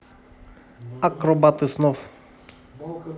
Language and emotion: Russian, neutral